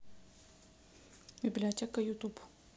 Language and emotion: Russian, neutral